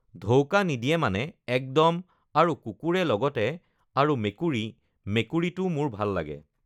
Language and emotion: Assamese, neutral